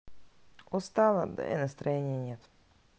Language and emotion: Russian, sad